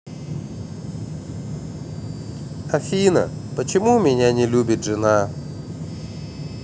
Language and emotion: Russian, sad